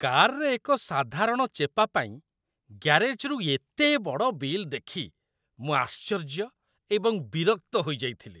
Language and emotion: Odia, disgusted